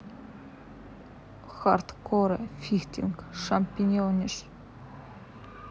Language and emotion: Russian, neutral